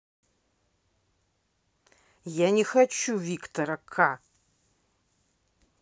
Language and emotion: Russian, angry